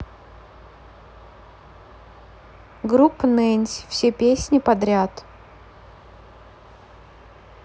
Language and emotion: Russian, neutral